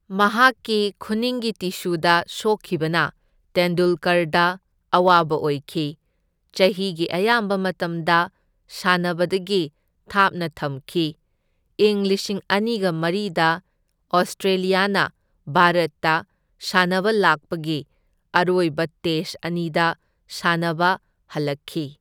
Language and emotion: Manipuri, neutral